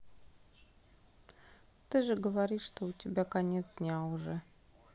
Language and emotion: Russian, sad